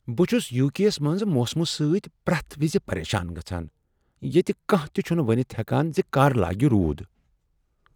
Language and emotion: Kashmiri, surprised